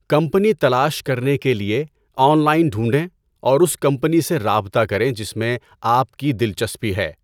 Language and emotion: Urdu, neutral